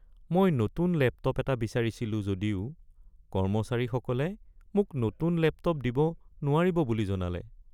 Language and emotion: Assamese, sad